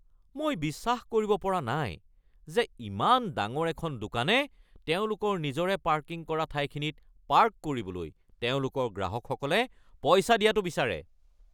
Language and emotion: Assamese, angry